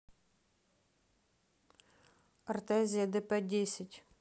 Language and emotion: Russian, neutral